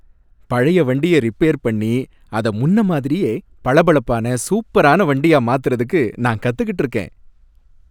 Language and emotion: Tamil, happy